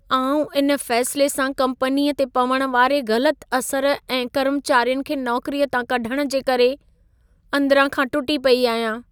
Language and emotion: Sindhi, sad